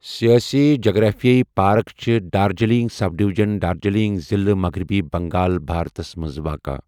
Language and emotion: Kashmiri, neutral